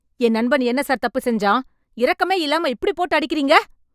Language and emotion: Tamil, angry